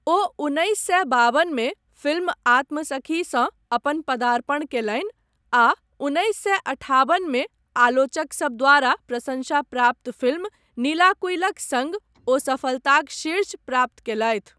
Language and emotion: Maithili, neutral